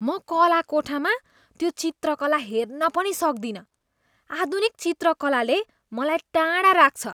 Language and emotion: Nepali, disgusted